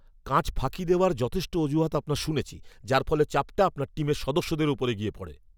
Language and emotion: Bengali, angry